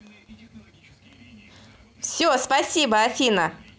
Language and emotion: Russian, positive